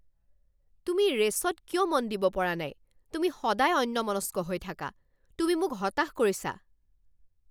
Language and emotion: Assamese, angry